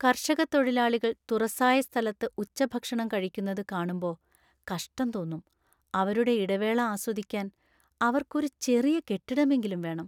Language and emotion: Malayalam, sad